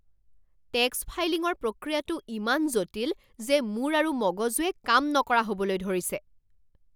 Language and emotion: Assamese, angry